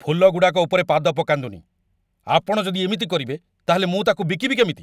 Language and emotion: Odia, angry